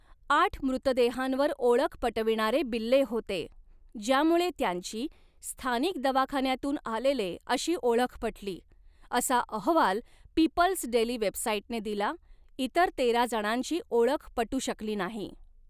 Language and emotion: Marathi, neutral